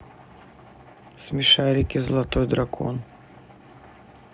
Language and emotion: Russian, neutral